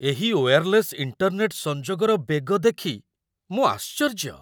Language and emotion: Odia, surprised